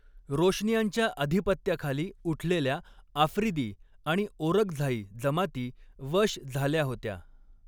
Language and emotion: Marathi, neutral